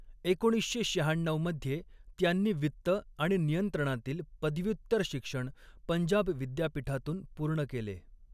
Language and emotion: Marathi, neutral